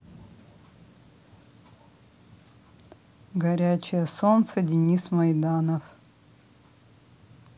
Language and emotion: Russian, neutral